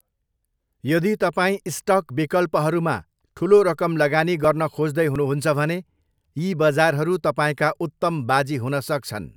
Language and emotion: Nepali, neutral